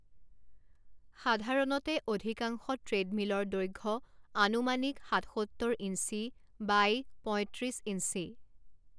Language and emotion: Assamese, neutral